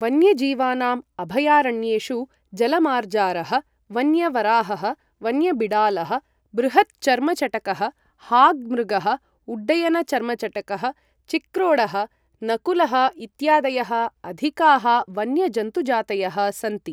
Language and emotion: Sanskrit, neutral